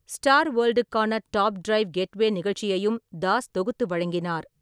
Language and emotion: Tamil, neutral